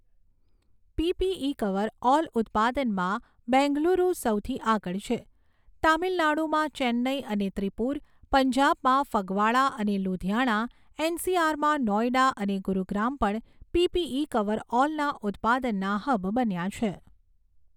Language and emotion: Gujarati, neutral